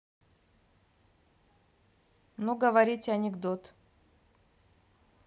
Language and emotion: Russian, neutral